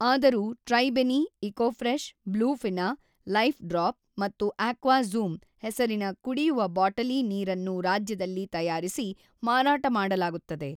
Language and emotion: Kannada, neutral